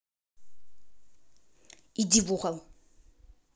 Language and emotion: Russian, angry